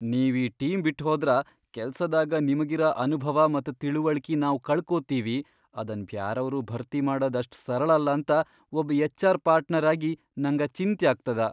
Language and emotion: Kannada, fearful